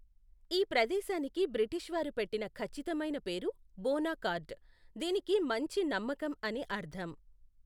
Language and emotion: Telugu, neutral